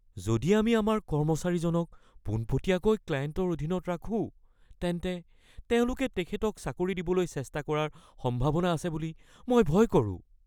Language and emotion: Assamese, fearful